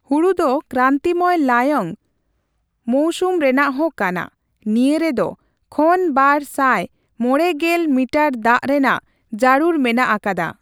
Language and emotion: Santali, neutral